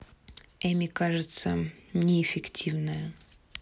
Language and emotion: Russian, neutral